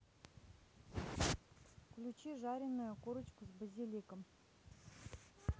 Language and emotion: Russian, neutral